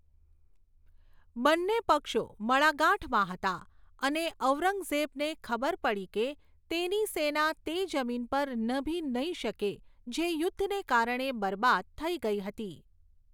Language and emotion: Gujarati, neutral